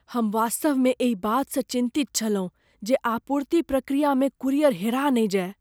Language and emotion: Maithili, fearful